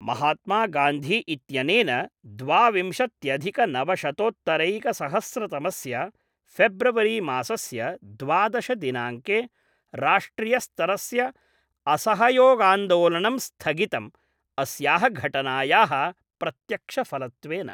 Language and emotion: Sanskrit, neutral